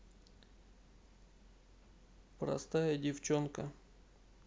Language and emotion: Russian, neutral